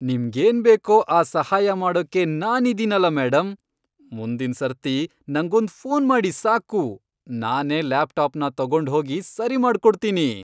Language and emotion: Kannada, happy